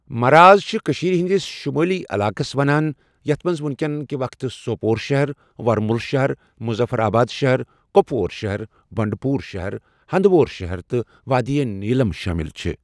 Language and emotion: Kashmiri, neutral